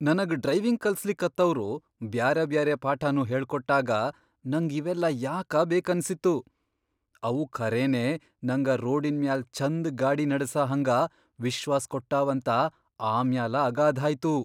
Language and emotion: Kannada, surprised